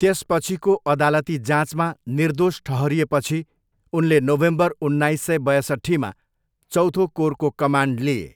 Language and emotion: Nepali, neutral